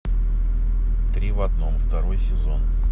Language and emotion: Russian, neutral